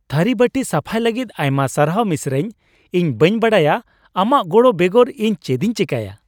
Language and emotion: Santali, happy